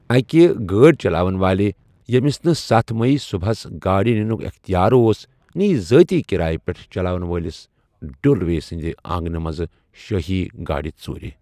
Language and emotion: Kashmiri, neutral